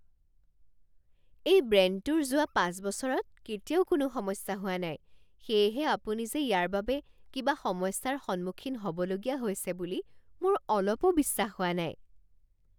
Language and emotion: Assamese, surprised